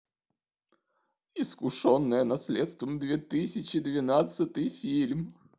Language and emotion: Russian, sad